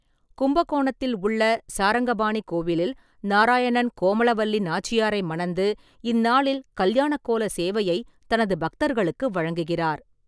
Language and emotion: Tamil, neutral